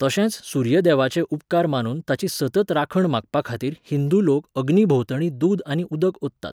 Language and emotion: Goan Konkani, neutral